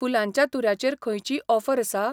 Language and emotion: Goan Konkani, neutral